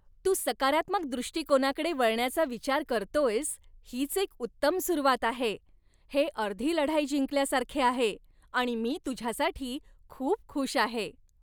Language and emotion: Marathi, happy